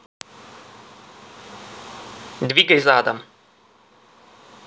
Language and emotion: Russian, neutral